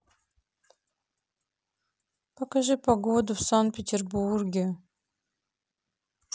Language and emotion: Russian, sad